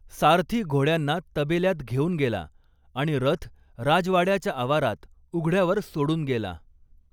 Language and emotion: Marathi, neutral